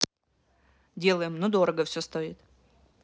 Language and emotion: Russian, neutral